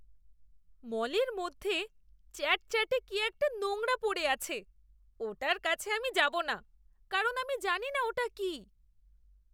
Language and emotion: Bengali, disgusted